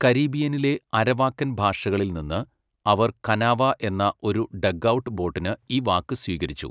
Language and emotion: Malayalam, neutral